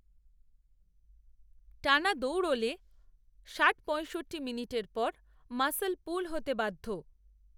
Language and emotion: Bengali, neutral